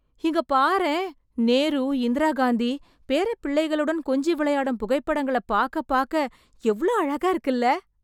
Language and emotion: Tamil, surprised